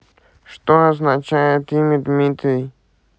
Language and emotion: Russian, neutral